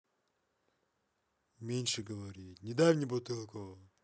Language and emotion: Russian, angry